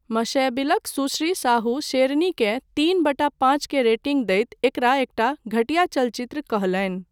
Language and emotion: Maithili, neutral